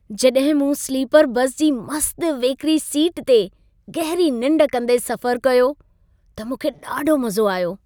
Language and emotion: Sindhi, happy